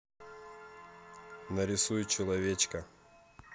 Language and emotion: Russian, neutral